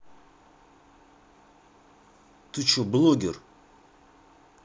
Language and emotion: Russian, angry